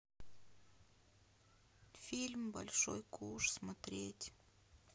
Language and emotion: Russian, sad